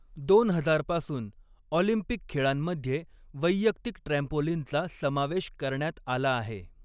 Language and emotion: Marathi, neutral